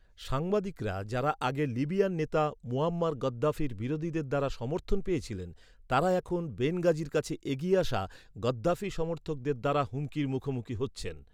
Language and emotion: Bengali, neutral